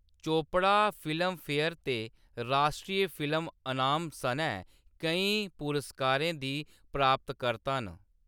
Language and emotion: Dogri, neutral